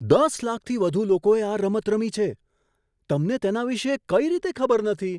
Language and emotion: Gujarati, surprised